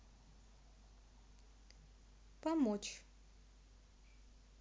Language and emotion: Russian, neutral